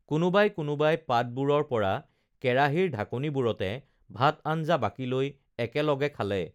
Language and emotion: Assamese, neutral